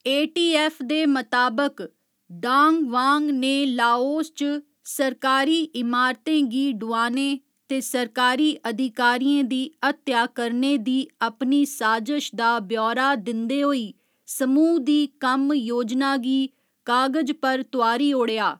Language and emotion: Dogri, neutral